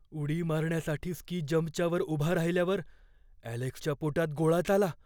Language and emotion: Marathi, fearful